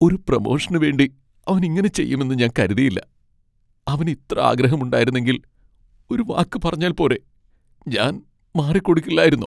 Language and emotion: Malayalam, sad